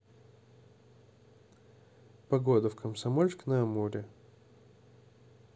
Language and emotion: Russian, neutral